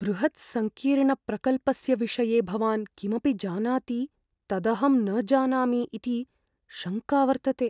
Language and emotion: Sanskrit, fearful